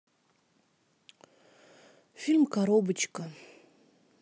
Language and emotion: Russian, sad